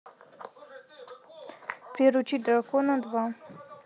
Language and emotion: Russian, neutral